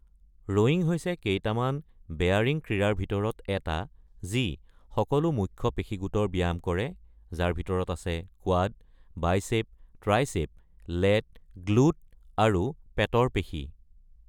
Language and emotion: Assamese, neutral